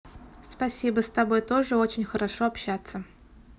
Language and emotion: Russian, positive